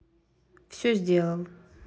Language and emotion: Russian, neutral